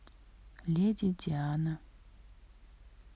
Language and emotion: Russian, neutral